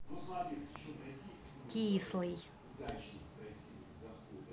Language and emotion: Russian, angry